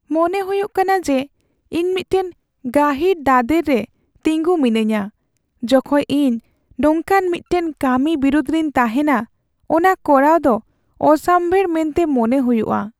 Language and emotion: Santali, sad